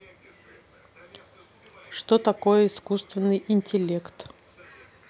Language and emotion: Russian, neutral